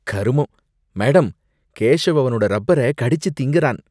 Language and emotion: Tamil, disgusted